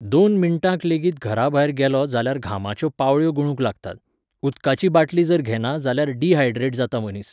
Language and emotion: Goan Konkani, neutral